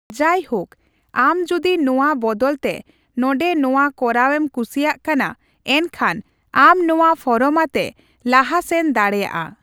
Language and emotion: Santali, neutral